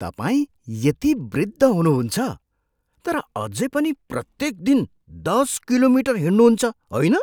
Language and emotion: Nepali, surprised